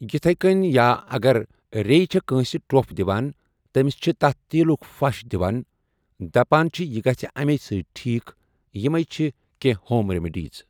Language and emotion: Kashmiri, neutral